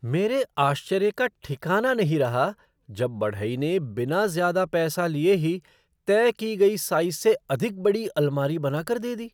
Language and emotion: Hindi, surprised